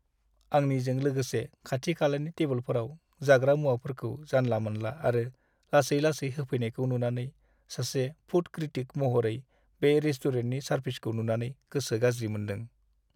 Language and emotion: Bodo, sad